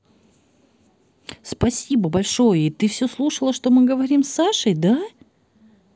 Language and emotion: Russian, positive